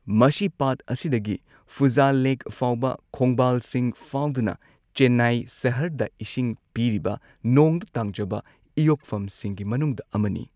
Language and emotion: Manipuri, neutral